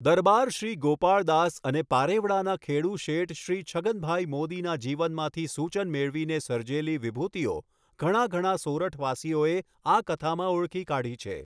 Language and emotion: Gujarati, neutral